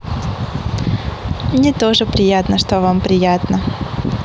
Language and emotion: Russian, positive